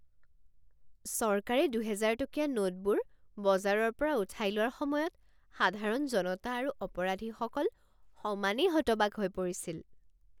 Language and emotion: Assamese, surprised